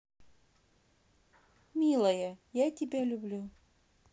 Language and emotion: Russian, positive